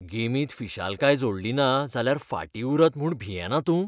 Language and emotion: Goan Konkani, fearful